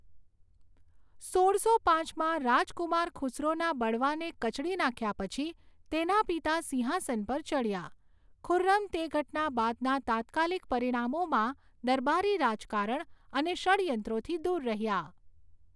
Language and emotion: Gujarati, neutral